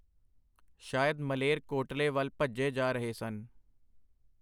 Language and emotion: Punjabi, neutral